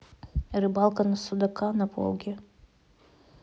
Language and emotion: Russian, neutral